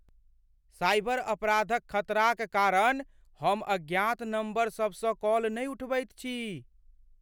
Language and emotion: Maithili, fearful